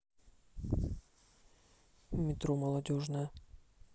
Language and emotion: Russian, neutral